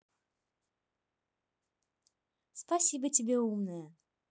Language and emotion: Russian, positive